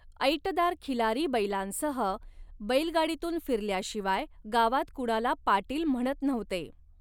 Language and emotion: Marathi, neutral